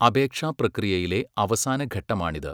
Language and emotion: Malayalam, neutral